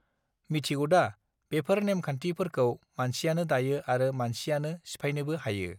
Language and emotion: Bodo, neutral